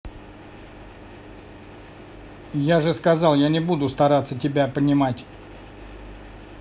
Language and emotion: Russian, angry